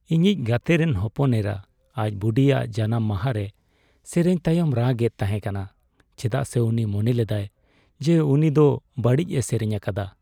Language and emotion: Santali, sad